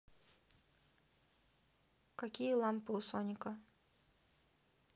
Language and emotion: Russian, neutral